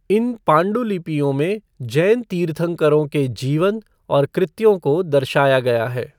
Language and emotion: Hindi, neutral